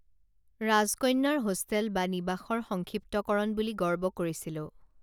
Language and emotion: Assamese, neutral